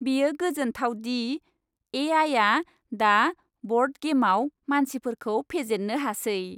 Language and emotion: Bodo, happy